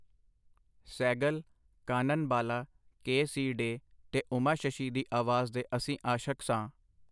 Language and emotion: Punjabi, neutral